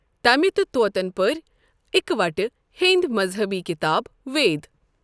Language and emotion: Kashmiri, neutral